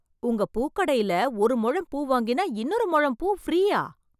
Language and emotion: Tamil, surprised